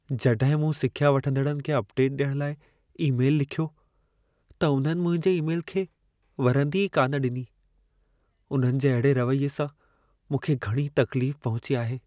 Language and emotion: Sindhi, sad